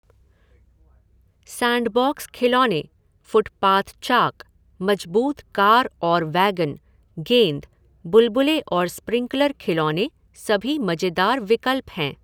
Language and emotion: Hindi, neutral